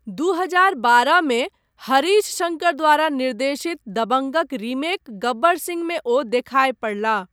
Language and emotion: Maithili, neutral